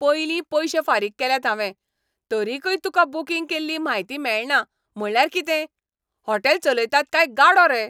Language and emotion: Goan Konkani, angry